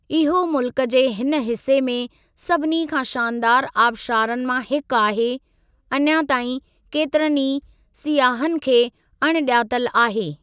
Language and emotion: Sindhi, neutral